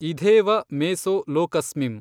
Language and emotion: Kannada, neutral